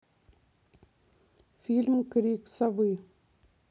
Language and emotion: Russian, neutral